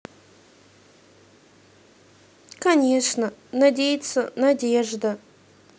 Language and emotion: Russian, neutral